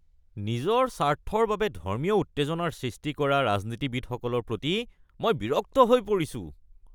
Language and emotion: Assamese, disgusted